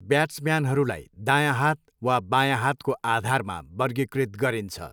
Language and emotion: Nepali, neutral